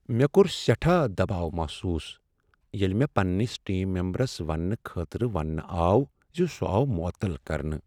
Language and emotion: Kashmiri, sad